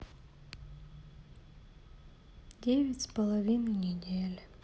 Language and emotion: Russian, sad